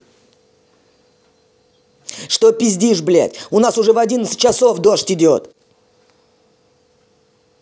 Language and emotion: Russian, angry